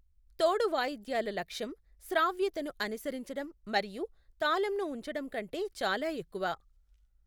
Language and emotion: Telugu, neutral